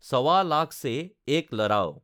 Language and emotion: Assamese, neutral